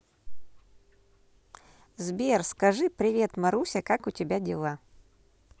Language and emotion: Russian, positive